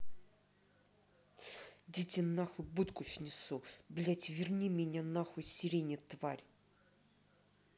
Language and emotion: Russian, angry